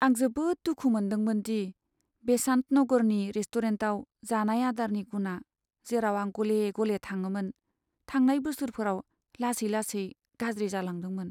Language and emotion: Bodo, sad